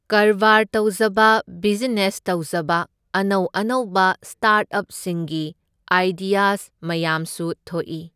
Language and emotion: Manipuri, neutral